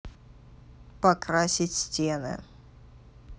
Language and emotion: Russian, neutral